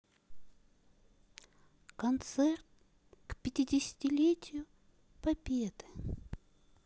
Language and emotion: Russian, sad